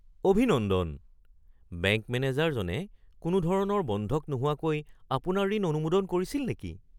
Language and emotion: Assamese, surprised